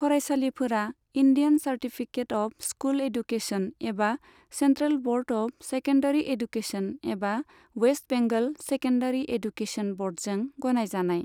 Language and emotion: Bodo, neutral